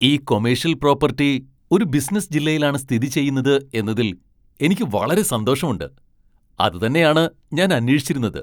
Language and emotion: Malayalam, surprised